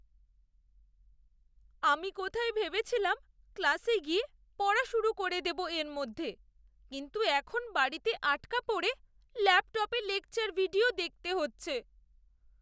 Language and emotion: Bengali, sad